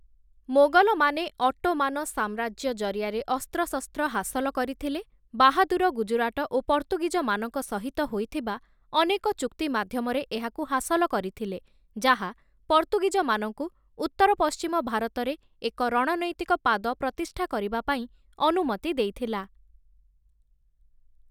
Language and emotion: Odia, neutral